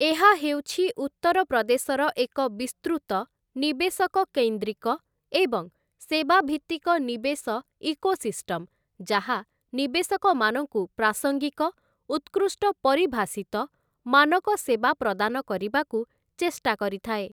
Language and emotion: Odia, neutral